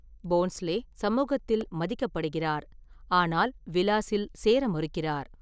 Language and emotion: Tamil, neutral